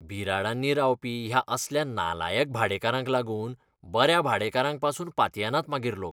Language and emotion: Goan Konkani, disgusted